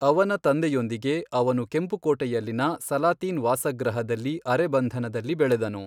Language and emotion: Kannada, neutral